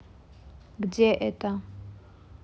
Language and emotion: Russian, neutral